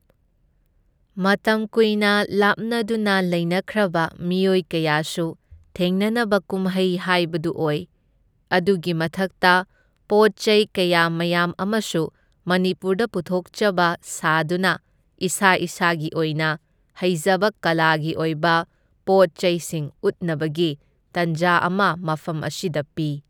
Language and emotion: Manipuri, neutral